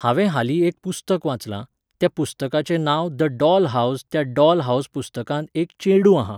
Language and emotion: Goan Konkani, neutral